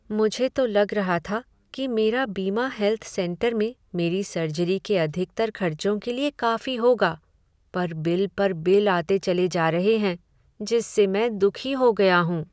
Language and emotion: Hindi, sad